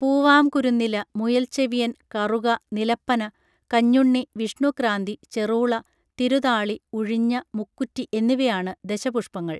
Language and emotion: Malayalam, neutral